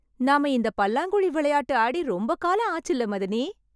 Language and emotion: Tamil, happy